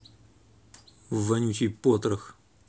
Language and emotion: Russian, angry